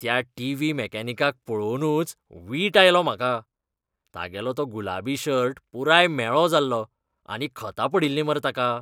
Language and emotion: Goan Konkani, disgusted